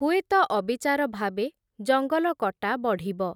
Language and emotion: Odia, neutral